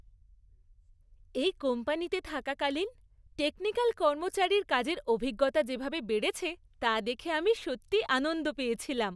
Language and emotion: Bengali, happy